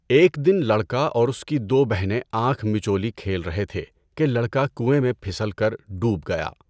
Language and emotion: Urdu, neutral